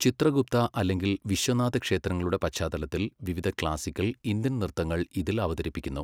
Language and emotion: Malayalam, neutral